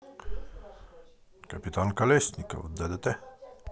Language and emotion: Russian, positive